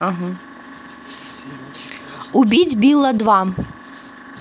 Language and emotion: Russian, positive